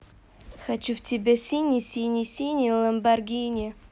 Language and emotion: Russian, positive